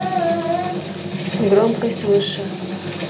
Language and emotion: Russian, neutral